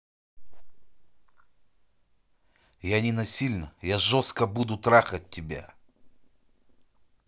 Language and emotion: Russian, angry